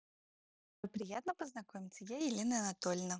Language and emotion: Russian, positive